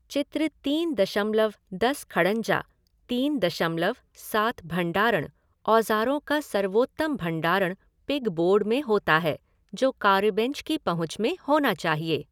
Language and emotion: Hindi, neutral